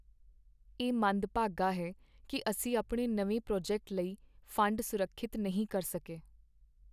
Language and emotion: Punjabi, sad